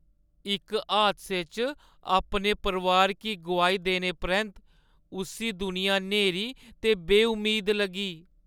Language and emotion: Dogri, sad